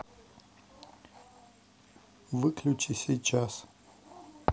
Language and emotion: Russian, neutral